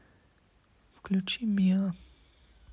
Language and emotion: Russian, neutral